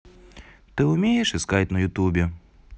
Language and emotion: Russian, neutral